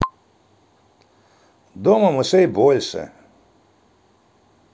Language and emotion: Russian, positive